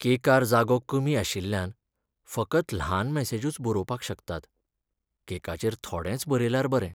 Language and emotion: Goan Konkani, sad